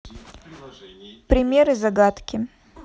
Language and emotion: Russian, neutral